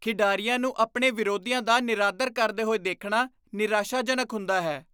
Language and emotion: Punjabi, disgusted